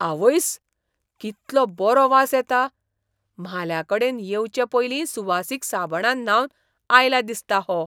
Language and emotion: Goan Konkani, surprised